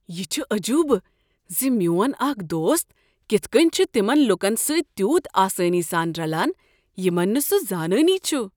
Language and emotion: Kashmiri, surprised